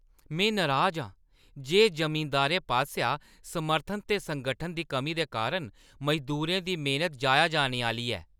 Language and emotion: Dogri, angry